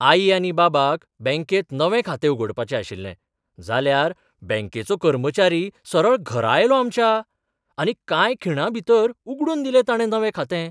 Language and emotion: Goan Konkani, surprised